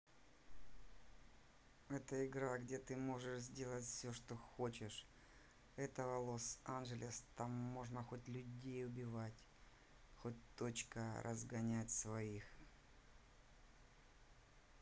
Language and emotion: Russian, neutral